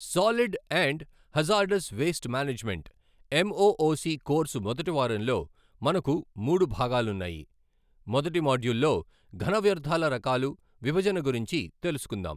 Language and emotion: Telugu, neutral